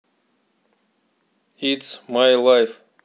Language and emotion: Russian, neutral